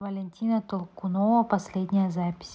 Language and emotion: Russian, neutral